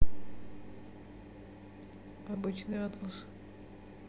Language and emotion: Russian, neutral